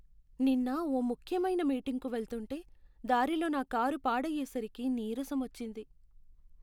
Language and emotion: Telugu, sad